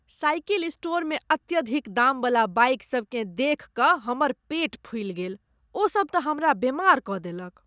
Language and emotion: Maithili, disgusted